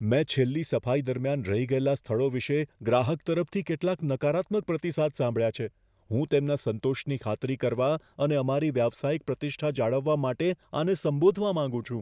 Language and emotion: Gujarati, fearful